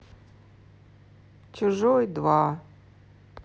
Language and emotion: Russian, sad